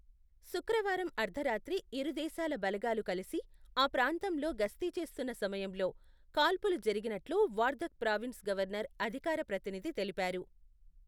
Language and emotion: Telugu, neutral